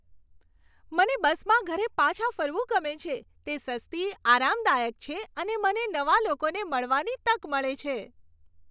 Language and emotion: Gujarati, happy